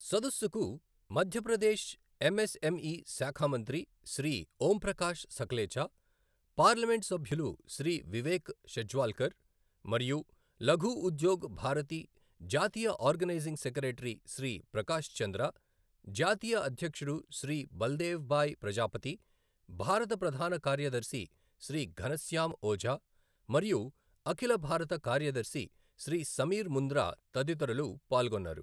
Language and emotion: Telugu, neutral